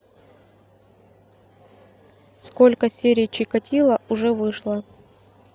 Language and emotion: Russian, neutral